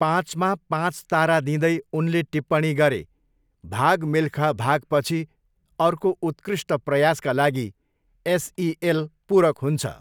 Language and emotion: Nepali, neutral